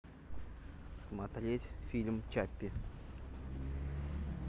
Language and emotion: Russian, neutral